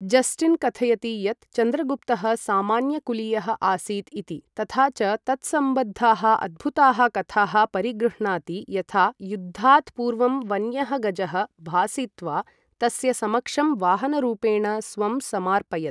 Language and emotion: Sanskrit, neutral